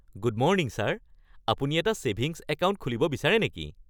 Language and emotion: Assamese, happy